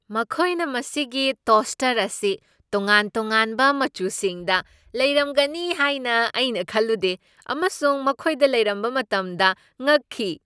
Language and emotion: Manipuri, surprised